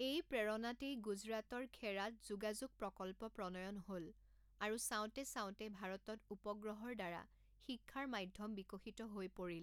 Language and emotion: Assamese, neutral